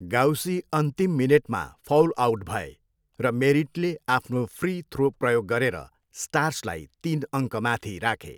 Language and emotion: Nepali, neutral